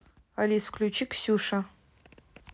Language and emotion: Russian, neutral